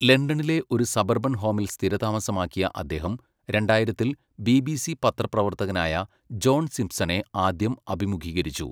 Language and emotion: Malayalam, neutral